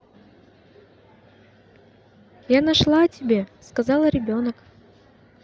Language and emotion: Russian, positive